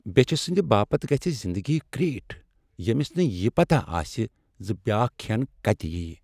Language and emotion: Kashmiri, sad